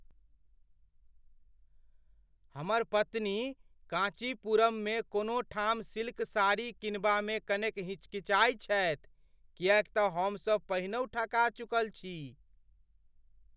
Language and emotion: Maithili, fearful